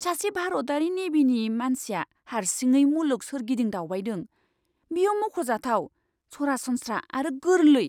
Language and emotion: Bodo, surprised